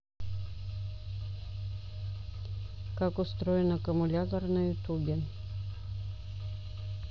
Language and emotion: Russian, neutral